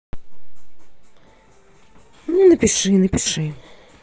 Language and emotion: Russian, neutral